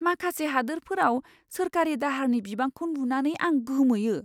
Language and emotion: Bodo, surprised